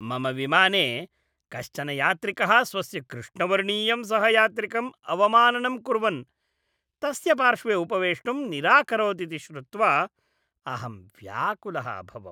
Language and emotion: Sanskrit, disgusted